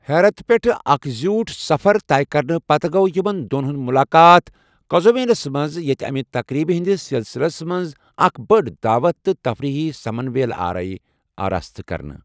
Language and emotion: Kashmiri, neutral